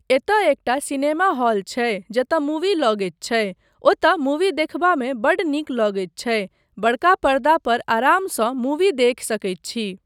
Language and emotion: Maithili, neutral